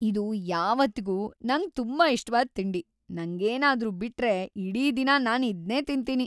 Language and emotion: Kannada, happy